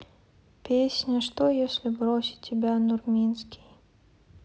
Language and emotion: Russian, sad